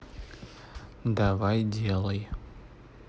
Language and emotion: Russian, neutral